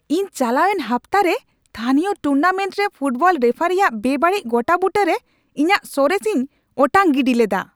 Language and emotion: Santali, angry